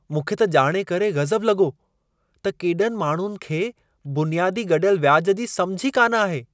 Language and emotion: Sindhi, surprised